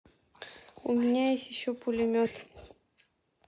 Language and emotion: Russian, neutral